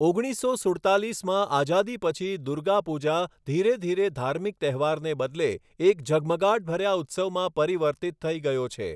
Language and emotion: Gujarati, neutral